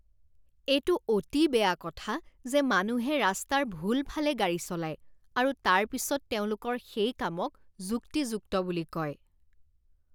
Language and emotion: Assamese, disgusted